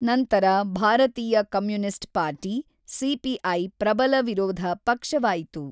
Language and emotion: Kannada, neutral